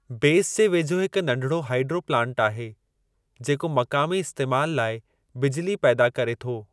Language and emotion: Sindhi, neutral